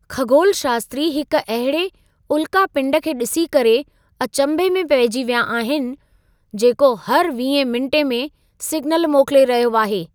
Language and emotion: Sindhi, surprised